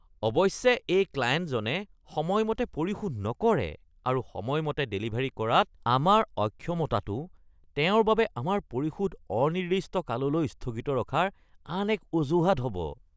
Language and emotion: Assamese, disgusted